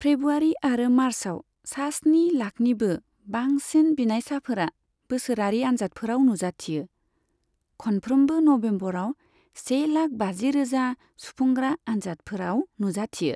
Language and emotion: Bodo, neutral